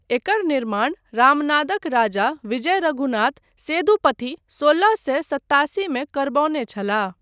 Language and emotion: Maithili, neutral